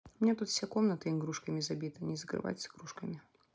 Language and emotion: Russian, neutral